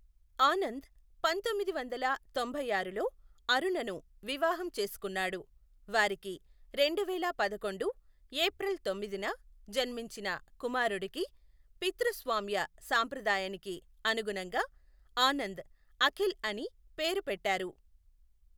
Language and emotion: Telugu, neutral